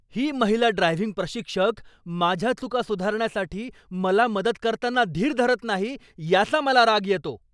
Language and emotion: Marathi, angry